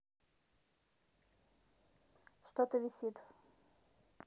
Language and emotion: Russian, neutral